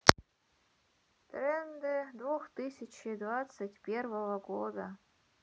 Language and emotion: Russian, neutral